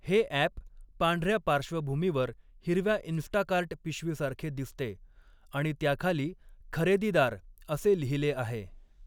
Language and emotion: Marathi, neutral